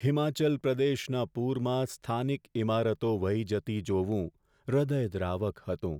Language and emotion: Gujarati, sad